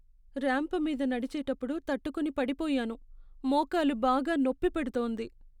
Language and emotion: Telugu, sad